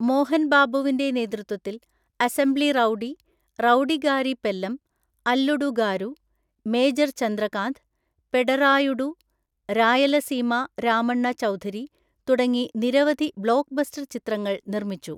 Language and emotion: Malayalam, neutral